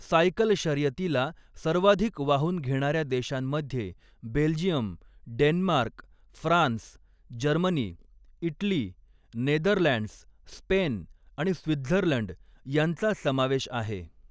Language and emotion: Marathi, neutral